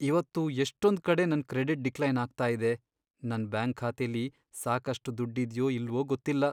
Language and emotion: Kannada, sad